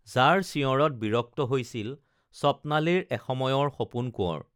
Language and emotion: Assamese, neutral